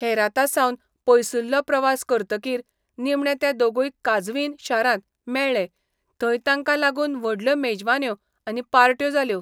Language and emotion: Goan Konkani, neutral